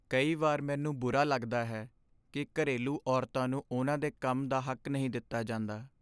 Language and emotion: Punjabi, sad